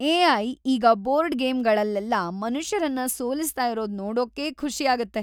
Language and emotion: Kannada, happy